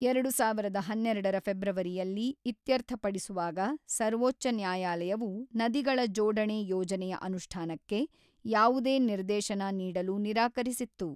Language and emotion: Kannada, neutral